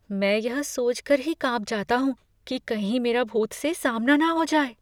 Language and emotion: Hindi, fearful